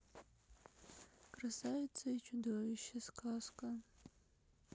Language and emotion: Russian, sad